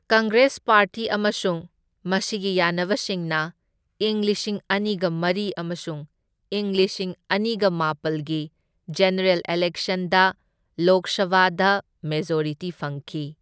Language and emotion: Manipuri, neutral